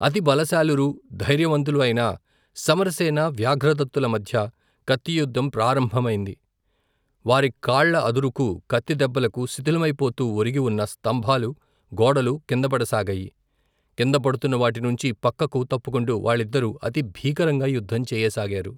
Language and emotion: Telugu, neutral